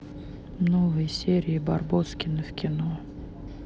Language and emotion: Russian, neutral